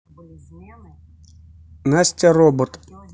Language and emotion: Russian, neutral